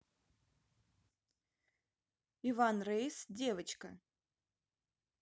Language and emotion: Russian, neutral